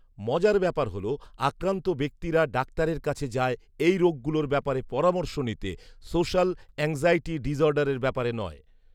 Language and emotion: Bengali, neutral